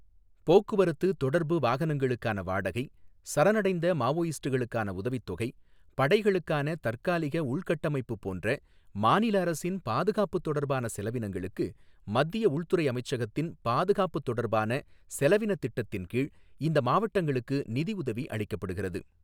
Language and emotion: Tamil, neutral